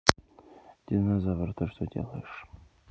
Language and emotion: Russian, neutral